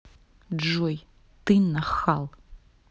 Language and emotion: Russian, angry